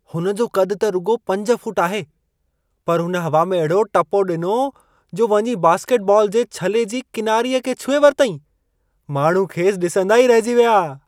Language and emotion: Sindhi, surprised